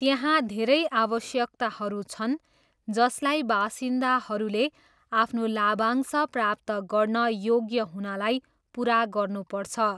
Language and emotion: Nepali, neutral